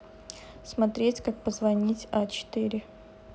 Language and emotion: Russian, neutral